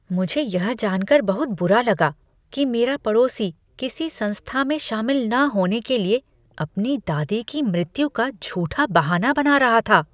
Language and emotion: Hindi, disgusted